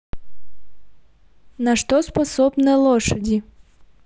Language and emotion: Russian, neutral